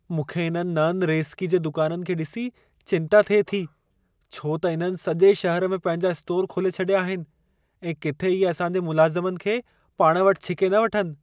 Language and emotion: Sindhi, fearful